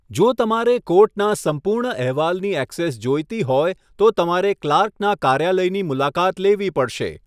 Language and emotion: Gujarati, neutral